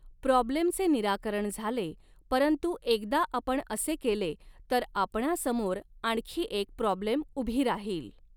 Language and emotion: Marathi, neutral